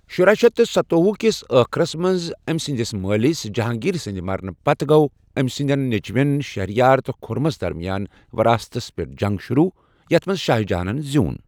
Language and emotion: Kashmiri, neutral